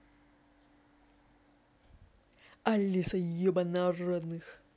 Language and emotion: Russian, angry